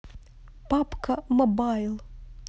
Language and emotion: Russian, neutral